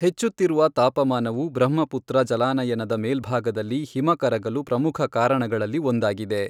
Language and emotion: Kannada, neutral